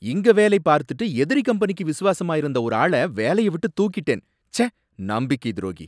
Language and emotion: Tamil, angry